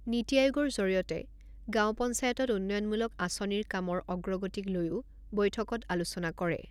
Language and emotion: Assamese, neutral